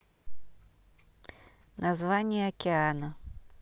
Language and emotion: Russian, neutral